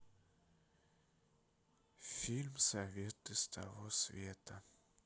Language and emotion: Russian, sad